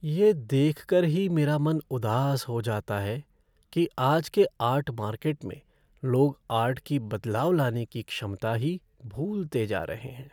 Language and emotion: Hindi, sad